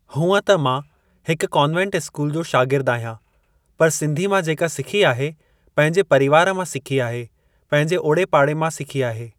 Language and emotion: Sindhi, neutral